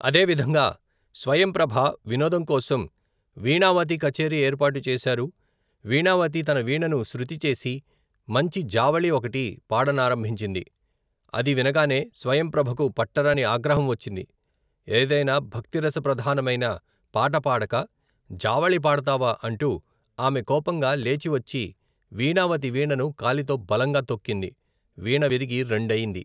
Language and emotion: Telugu, neutral